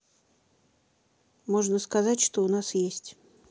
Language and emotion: Russian, neutral